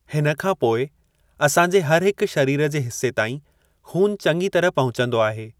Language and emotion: Sindhi, neutral